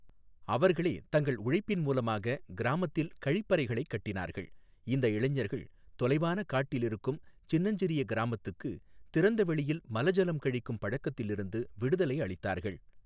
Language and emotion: Tamil, neutral